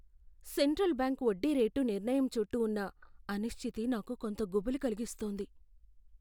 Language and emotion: Telugu, fearful